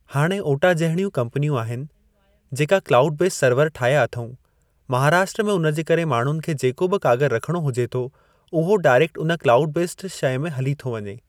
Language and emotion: Sindhi, neutral